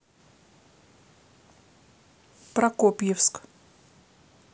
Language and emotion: Russian, neutral